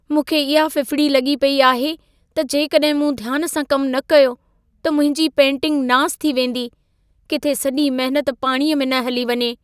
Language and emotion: Sindhi, fearful